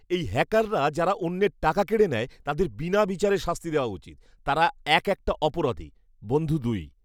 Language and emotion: Bengali, angry